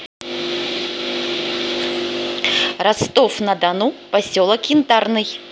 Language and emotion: Russian, positive